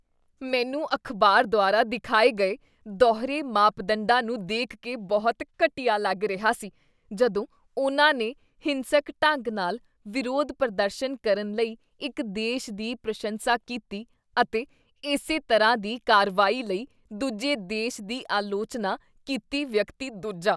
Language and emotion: Punjabi, disgusted